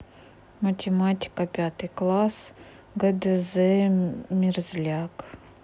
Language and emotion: Russian, neutral